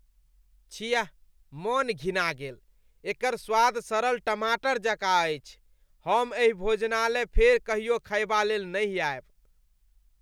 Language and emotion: Maithili, disgusted